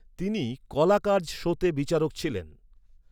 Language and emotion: Bengali, neutral